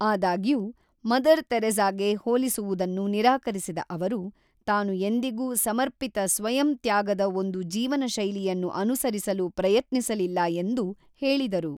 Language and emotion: Kannada, neutral